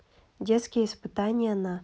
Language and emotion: Russian, neutral